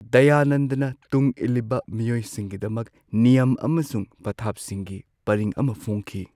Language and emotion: Manipuri, neutral